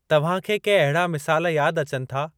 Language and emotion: Sindhi, neutral